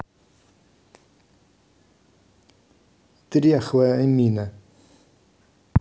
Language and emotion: Russian, neutral